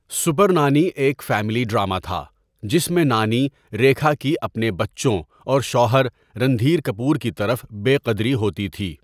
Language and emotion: Urdu, neutral